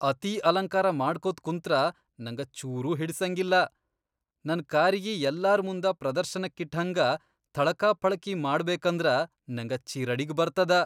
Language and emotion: Kannada, disgusted